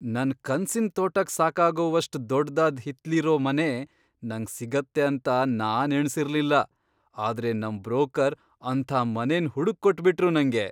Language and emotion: Kannada, surprised